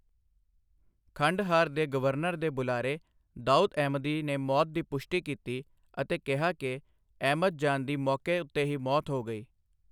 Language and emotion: Punjabi, neutral